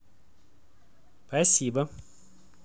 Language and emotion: Russian, positive